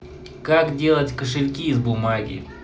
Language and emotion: Russian, neutral